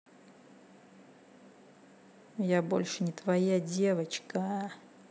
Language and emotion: Russian, neutral